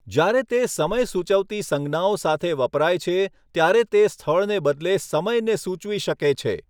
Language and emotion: Gujarati, neutral